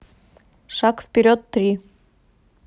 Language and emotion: Russian, neutral